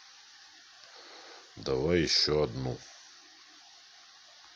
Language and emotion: Russian, neutral